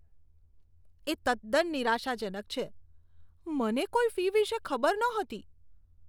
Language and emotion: Gujarati, disgusted